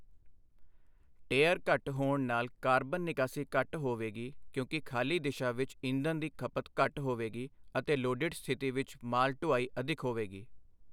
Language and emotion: Punjabi, neutral